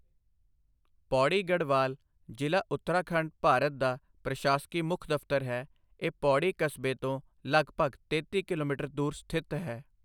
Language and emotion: Punjabi, neutral